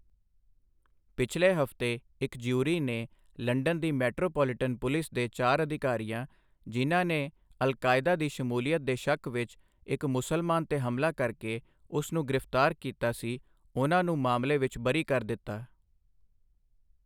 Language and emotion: Punjabi, neutral